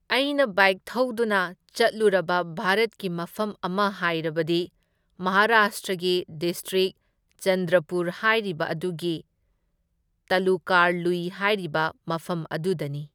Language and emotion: Manipuri, neutral